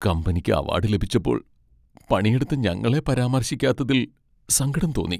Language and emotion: Malayalam, sad